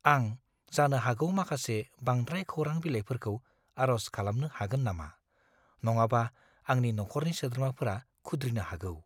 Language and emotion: Bodo, fearful